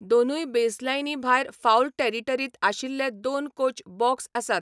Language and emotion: Goan Konkani, neutral